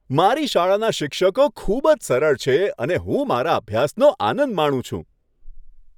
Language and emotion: Gujarati, happy